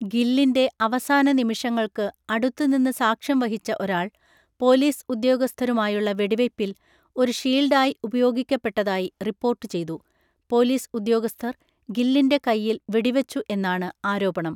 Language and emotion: Malayalam, neutral